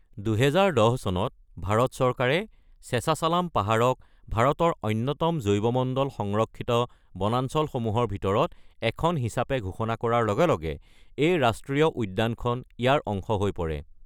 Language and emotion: Assamese, neutral